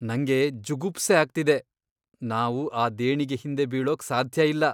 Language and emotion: Kannada, disgusted